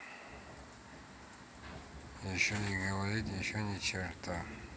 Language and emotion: Russian, neutral